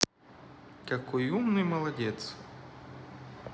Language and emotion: Russian, positive